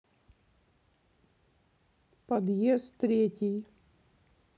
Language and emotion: Russian, neutral